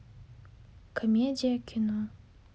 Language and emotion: Russian, sad